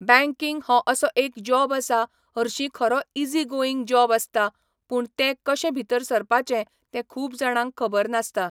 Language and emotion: Goan Konkani, neutral